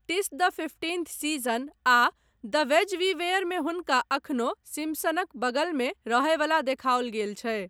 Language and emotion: Maithili, neutral